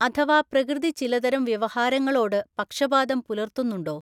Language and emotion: Malayalam, neutral